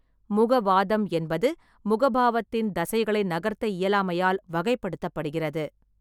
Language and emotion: Tamil, neutral